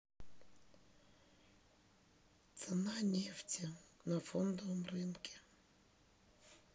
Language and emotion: Russian, neutral